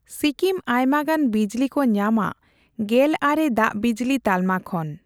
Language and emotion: Santali, neutral